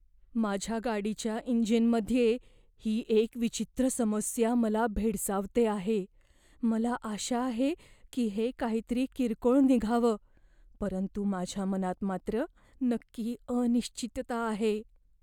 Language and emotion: Marathi, fearful